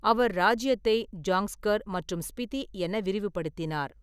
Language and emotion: Tamil, neutral